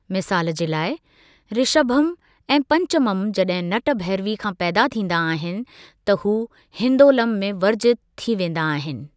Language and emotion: Sindhi, neutral